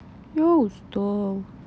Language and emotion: Russian, sad